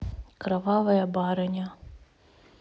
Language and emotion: Russian, neutral